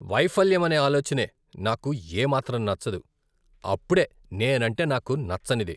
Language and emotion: Telugu, disgusted